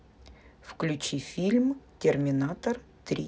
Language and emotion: Russian, neutral